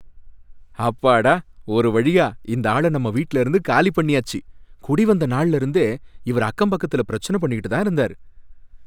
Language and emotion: Tamil, happy